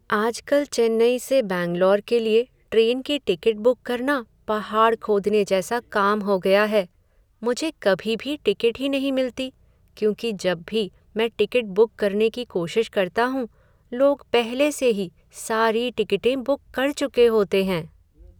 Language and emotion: Hindi, sad